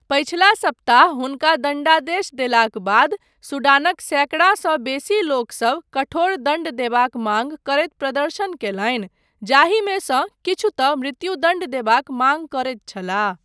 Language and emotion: Maithili, neutral